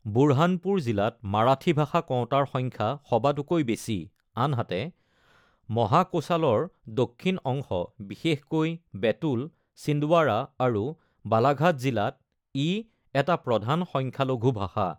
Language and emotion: Assamese, neutral